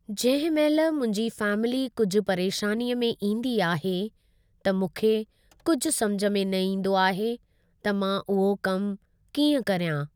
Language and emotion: Sindhi, neutral